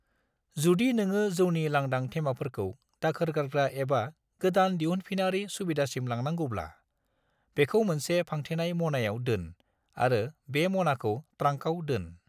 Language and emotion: Bodo, neutral